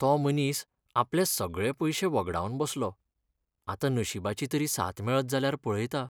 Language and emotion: Goan Konkani, sad